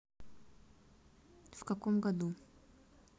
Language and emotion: Russian, neutral